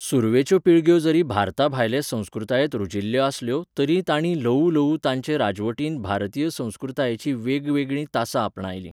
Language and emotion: Goan Konkani, neutral